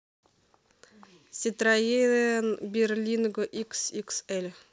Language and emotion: Russian, neutral